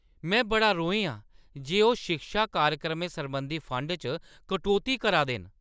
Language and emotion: Dogri, angry